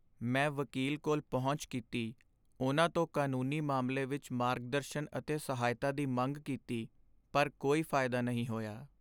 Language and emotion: Punjabi, sad